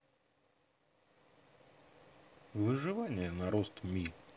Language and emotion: Russian, neutral